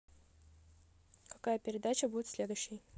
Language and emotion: Russian, neutral